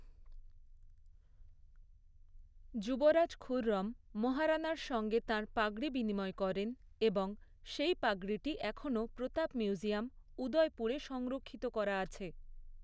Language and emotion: Bengali, neutral